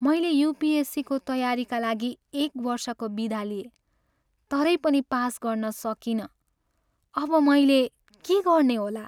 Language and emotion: Nepali, sad